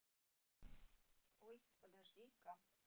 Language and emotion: Russian, neutral